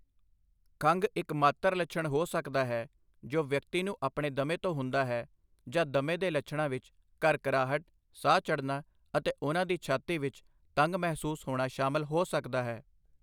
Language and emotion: Punjabi, neutral